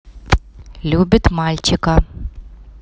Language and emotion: Russian, neutral